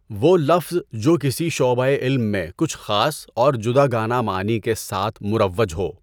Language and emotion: Urdu, neutral